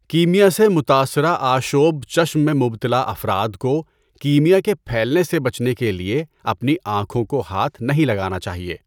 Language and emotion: Urdu, neutral